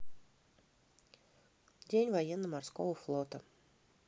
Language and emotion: Russian, neutral